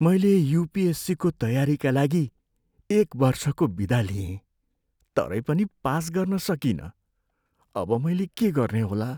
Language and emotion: Nepali, sad